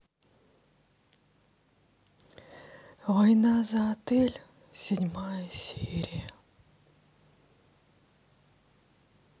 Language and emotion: Russian, sad